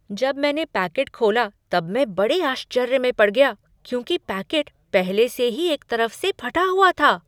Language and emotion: Hindi, surprised